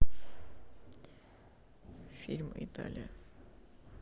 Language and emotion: Russian, sad